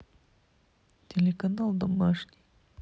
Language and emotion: Russian, neutral